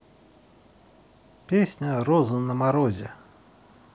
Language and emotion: Russian, neutral